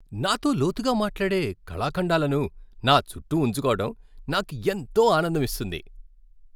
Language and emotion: Telugu, happy